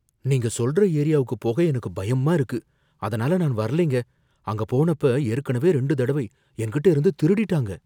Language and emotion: Tamil, fearful